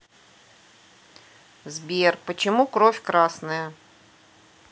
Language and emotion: Russian, neutral